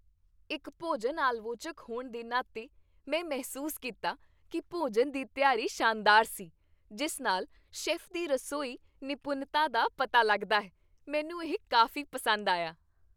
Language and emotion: Punjabi, happy